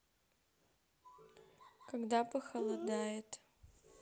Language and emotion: Russian, neutral